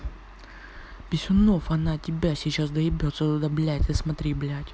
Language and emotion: Russian, angry